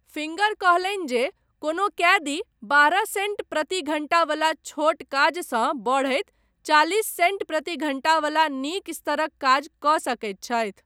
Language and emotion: Maithili, neutral